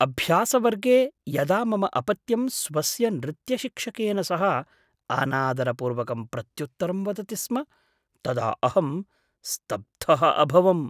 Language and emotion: Sanskrit, surprised